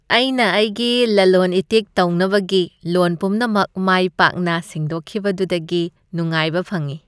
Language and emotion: Manipuri, happy